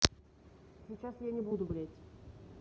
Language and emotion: Russian, angry